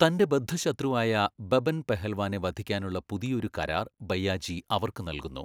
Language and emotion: Malayalam, neutral